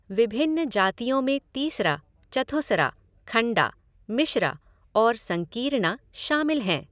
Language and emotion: Hindi, neutral